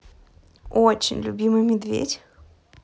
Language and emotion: Russian, positive